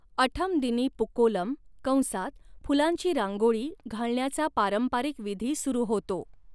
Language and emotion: Marathi, neutral